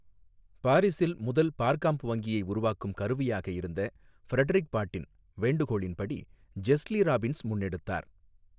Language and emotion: Tamil, neutral